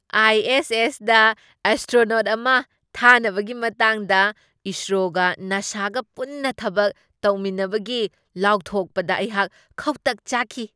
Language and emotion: Manipuri, surprised